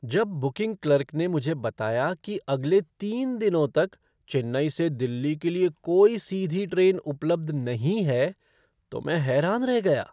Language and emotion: Hindi, surprised